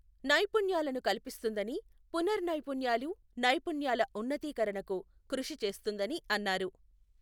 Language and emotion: Telugu, neutral